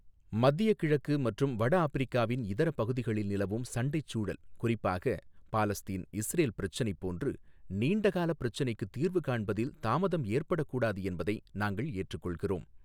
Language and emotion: Tamil, neutral